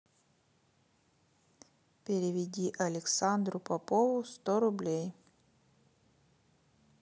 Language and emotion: Russian, neutral